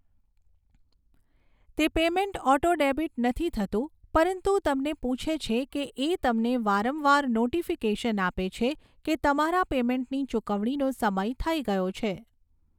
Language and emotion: Gujarati, neutral